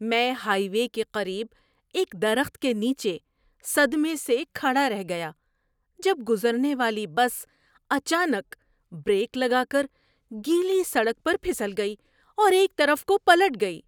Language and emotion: Urdu, surprised